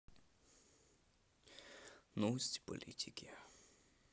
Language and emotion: Russian, sad